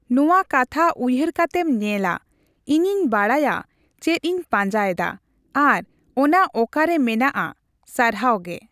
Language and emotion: Santali, neutral